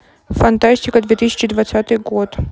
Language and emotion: Russian, neutral